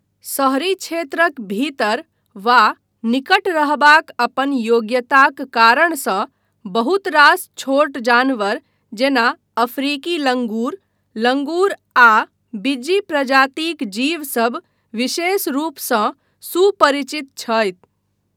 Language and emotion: Maithili, neutral